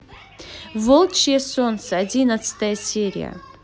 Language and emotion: Russian, positive